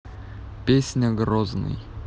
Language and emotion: Russian, neutral